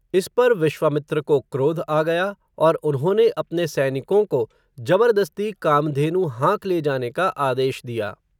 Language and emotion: Hindi, neutral